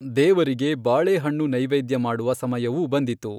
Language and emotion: Kannada, neutral